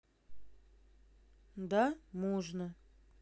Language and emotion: Russian, neutral